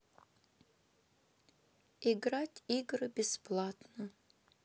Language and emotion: Russian, sad